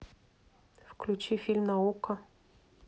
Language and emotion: Russian, neutral